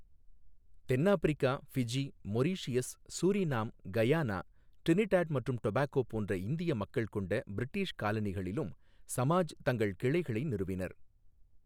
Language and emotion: Tamil, neutral